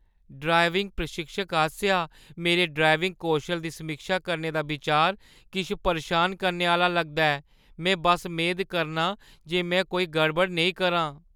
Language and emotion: Dogri, fearful